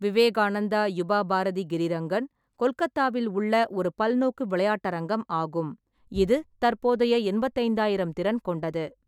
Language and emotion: Tamil, neutral